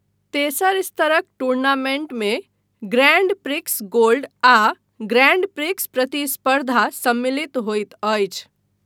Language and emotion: Maithili, neutral